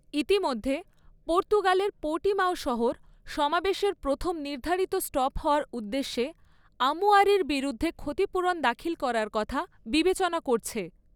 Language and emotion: Bengali, neutral